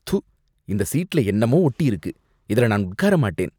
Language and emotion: Tamil, disgusted